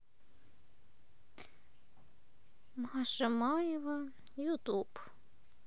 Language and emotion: Russian, sad